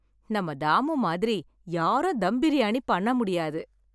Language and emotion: Tamil, happy